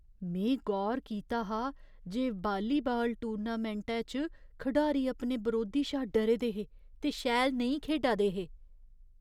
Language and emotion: Dogri, fearful